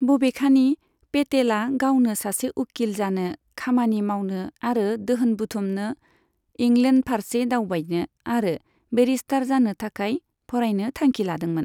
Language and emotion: Bodo, neutral